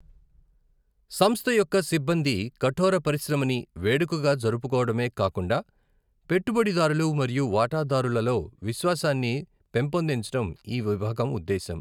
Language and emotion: Telugu, neutral